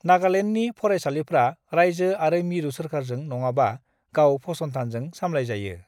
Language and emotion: Bodo, neutral